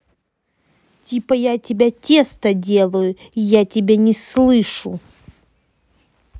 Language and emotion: Russian, angry